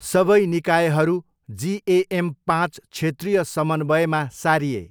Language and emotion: Nepali, neutral